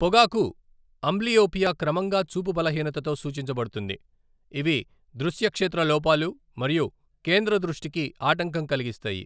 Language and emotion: Telugu, neutral